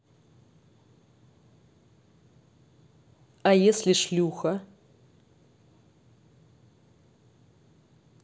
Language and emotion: Russian, neutral